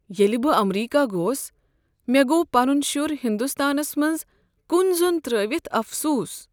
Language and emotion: Kashmiri, sad